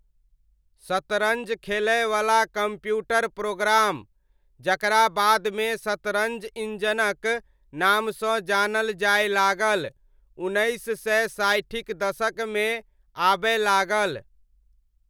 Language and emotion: Maithili, neutral